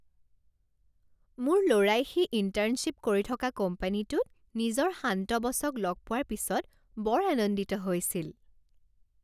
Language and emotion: Assamese, happy